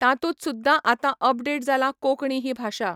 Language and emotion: Goan Konkani, neutral